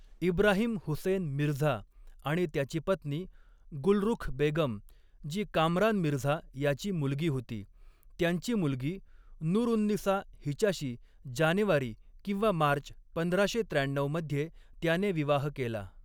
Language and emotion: Marathi, neutral